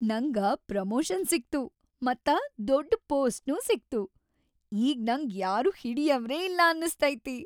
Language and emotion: Kannada, happy